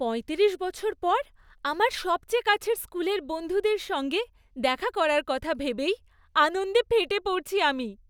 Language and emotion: Bengali, happy